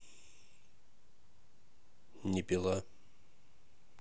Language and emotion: Russian, neutral